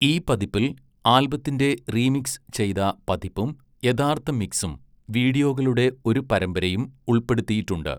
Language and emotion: Malayalam, neutral